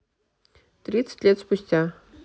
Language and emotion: Russian, neutral